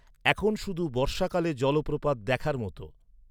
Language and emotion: Bengali, neutral